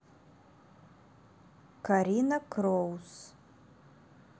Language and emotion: Russian, neutral